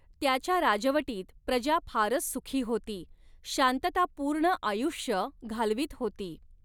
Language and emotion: Marathi, neutral